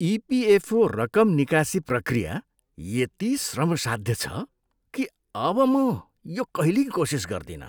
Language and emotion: Nepali, disgusted